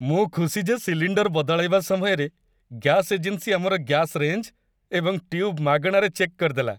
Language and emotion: Odia, happy